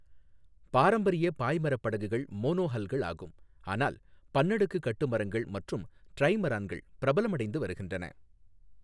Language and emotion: Tamil, neutral